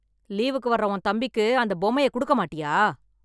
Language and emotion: Tamil, angry